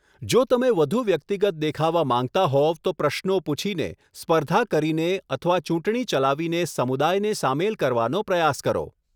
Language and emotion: Gujarati, neutral